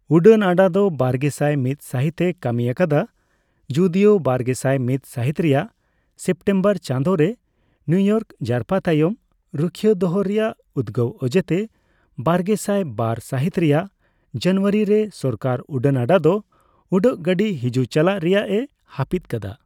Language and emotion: Santali, neutral